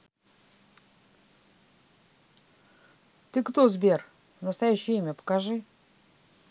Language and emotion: Russian, neutral